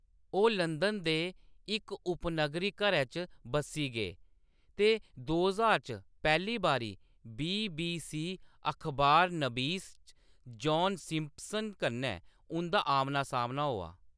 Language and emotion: Dogri, neutral